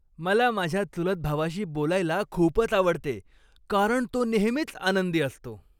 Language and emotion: Marathi, happy